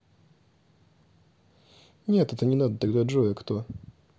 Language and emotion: Russian, neutral